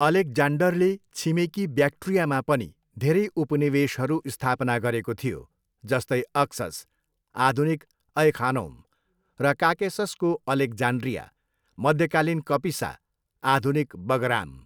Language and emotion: Nepali, neutral